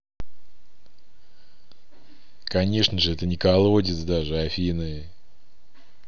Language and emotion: Russian, neutral